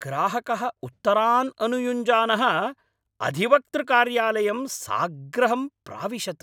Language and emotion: Sanskrit, angry